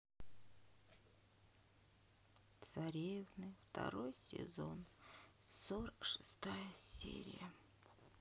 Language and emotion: Russian, sad